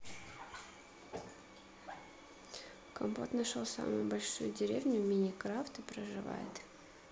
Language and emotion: Russian, neutral